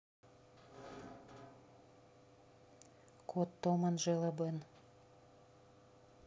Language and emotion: Russian, neutral